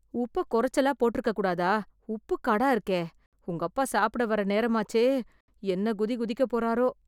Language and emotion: Tamil, fearful